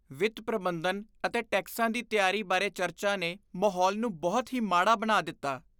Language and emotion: Punjabi, disgusted